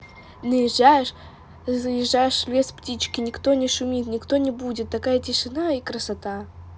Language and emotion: Russian, positive